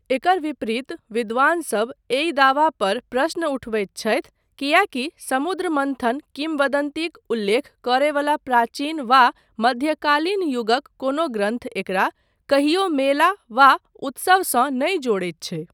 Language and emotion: Maithili, neutral